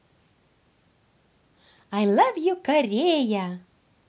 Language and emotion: Russian, positive